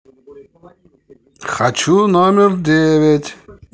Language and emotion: Russian, positive